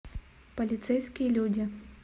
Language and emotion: Russian, neutral